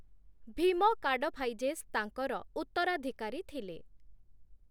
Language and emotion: Odia, neutral